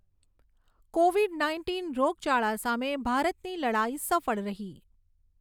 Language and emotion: Gujarati, neutral